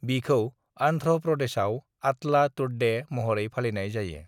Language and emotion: Bodo, neutral